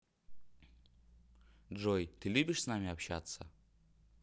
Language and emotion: Russian, neutral